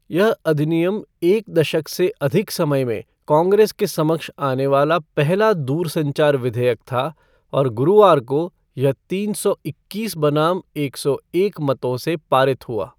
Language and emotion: Hindi, neutral